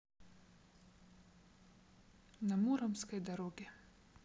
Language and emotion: Russian, neutral